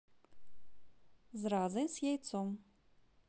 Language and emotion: Russian, positive